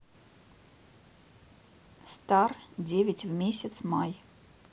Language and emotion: Russian, neutral